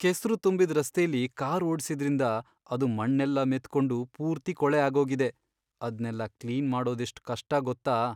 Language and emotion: Kannada, sad